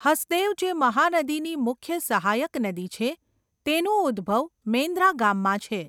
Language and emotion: Gujarati, neutral